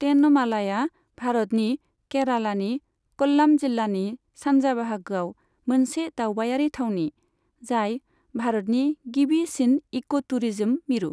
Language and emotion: Bodo, neutral